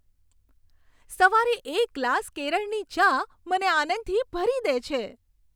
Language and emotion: Gujarati, happy